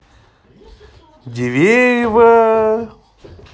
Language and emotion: Russian, positive